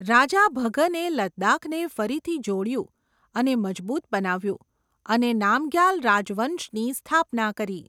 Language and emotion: Gujarati, neutral